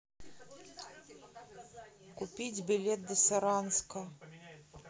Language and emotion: Russian, neutral